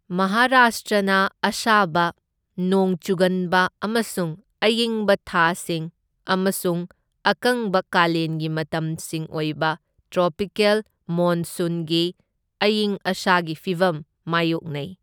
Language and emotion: Manipuri, neutral